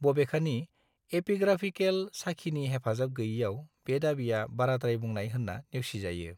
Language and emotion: Bodo, neutral